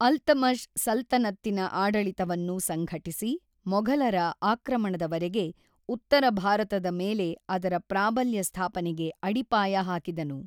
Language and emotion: Kannada, neutral